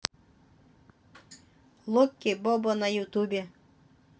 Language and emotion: Russian, neutral